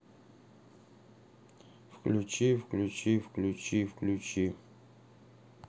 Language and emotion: Russian, neutral